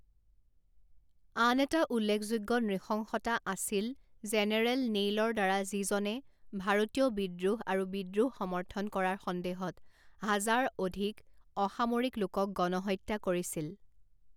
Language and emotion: Assamese, neutral